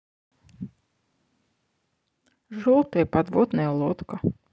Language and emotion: Russian, neutral